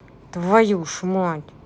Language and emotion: Russian, angry